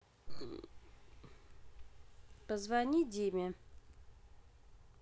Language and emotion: Russian, neutral